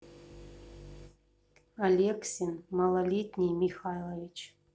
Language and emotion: Russian, neutral